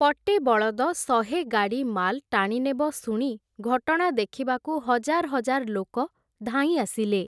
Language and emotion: Odia, neutral